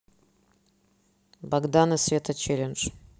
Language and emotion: Russian, neutral